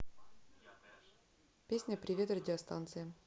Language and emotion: Russian, neutral